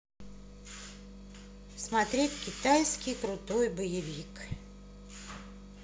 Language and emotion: Russian, neutral